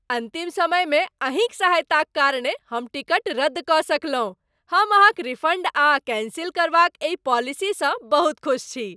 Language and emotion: Maithili, happy